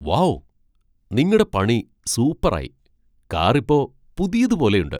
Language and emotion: Malayalam, surprised